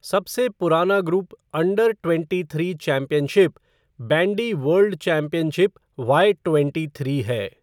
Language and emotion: Hindi, neutral